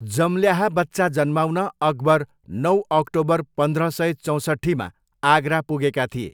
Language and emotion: Nepali, neutral